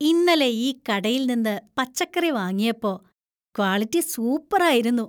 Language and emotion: Malayalam, happy